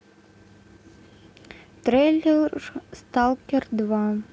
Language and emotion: Russian, neutral